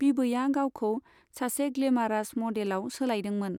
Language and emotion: Bodo, neutral